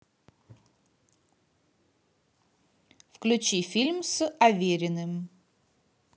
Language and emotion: Russian, positive